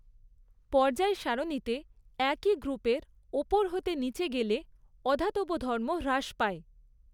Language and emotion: Bengali, neutral